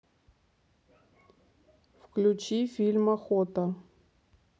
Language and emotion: Russian, neutral